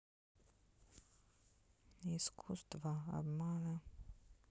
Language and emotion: Russian, sad